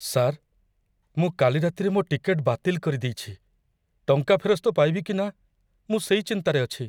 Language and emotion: Odia, fearful